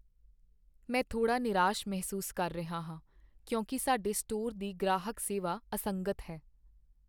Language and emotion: Punjabi, sad